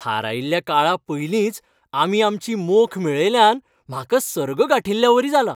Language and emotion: Goan Konkani, happy